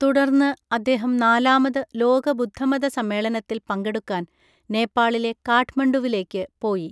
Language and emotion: Malayalam, neutral